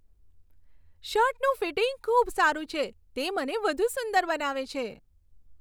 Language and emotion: Gujarati, happy